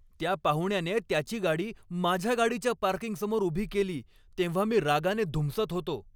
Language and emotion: Marathi, angry